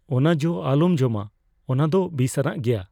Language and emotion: Santali, fearful